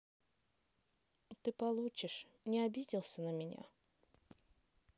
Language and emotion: Russian, neutral